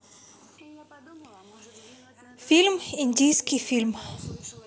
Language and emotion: Russian, neutral